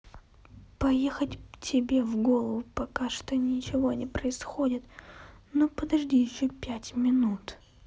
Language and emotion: Russian, sad